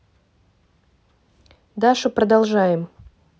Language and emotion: Russian, neutral